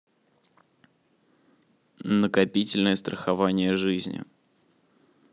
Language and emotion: Russian, neutral